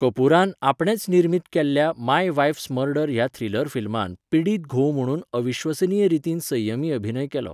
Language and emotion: Goan Konkani, neutral